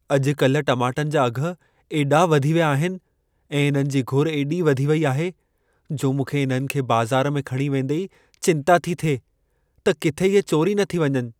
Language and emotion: Sindhi, fearful